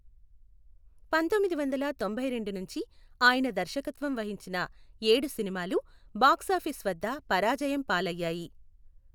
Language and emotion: Telugu, neutral